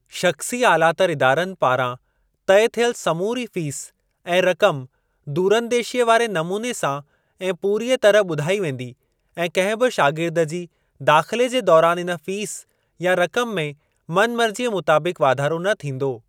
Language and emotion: Sindhi, neutral